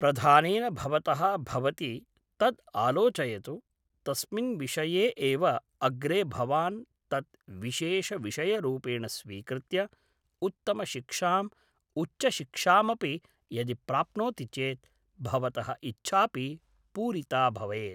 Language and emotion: Sanskrit, neutral